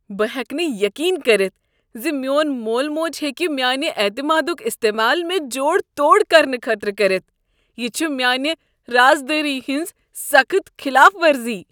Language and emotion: Kashmiri, disgusted